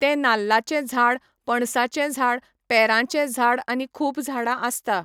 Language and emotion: Goan Konkani, neutral